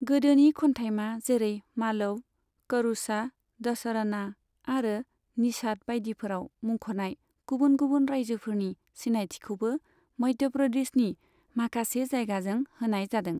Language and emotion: Bodo, neutral